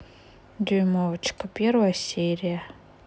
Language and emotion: Russian, sad